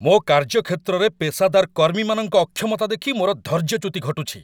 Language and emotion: Odia, angry